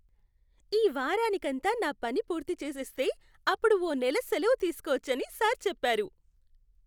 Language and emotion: Telugu, happy